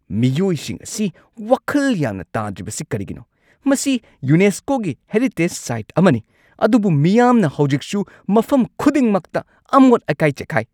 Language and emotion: Manipuri, angry